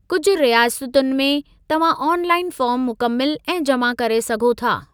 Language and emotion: Sindhi, neutral